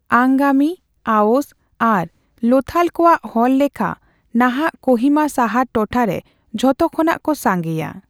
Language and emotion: Santali, neutral